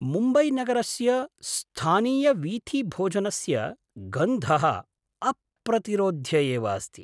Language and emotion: Sanskrit, surprised